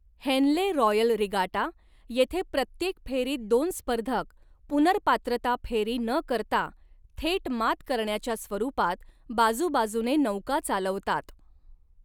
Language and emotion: Marathi, neutral